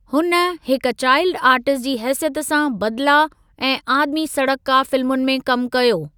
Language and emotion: Sindhi, neutral